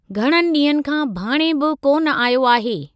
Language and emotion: Sindhi, neutral